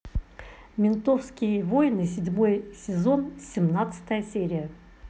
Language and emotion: Russian, neutral